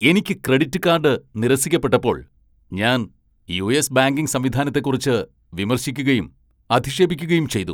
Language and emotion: Malayalam, angry